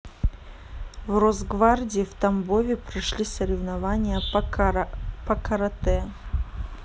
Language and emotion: Russian, neutral